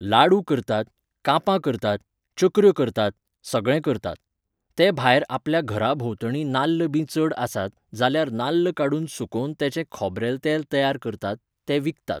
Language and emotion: Goan Konkani, neutral